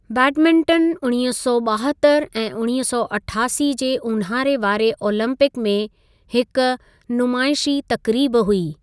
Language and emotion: Sindhi, neutral